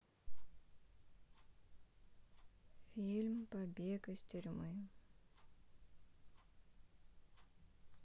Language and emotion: Russian, sad